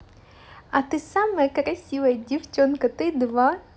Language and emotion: Russian, positive